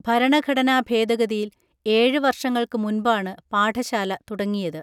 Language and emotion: Malayalam, neutral